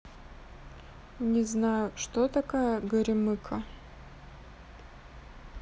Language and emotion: Russian, sad